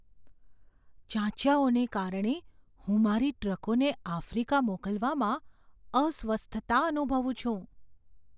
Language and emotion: Gujarati, fearful